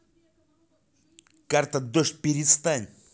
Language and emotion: Russian, angry